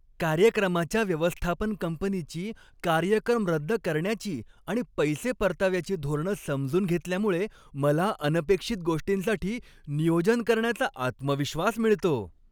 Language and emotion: Marathi, happy